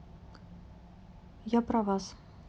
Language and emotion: Russian, neutral